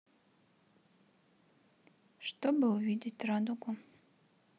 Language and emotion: Russian, sad